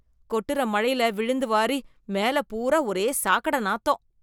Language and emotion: Tamil, disgusted